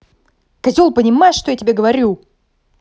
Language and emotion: Russian, angry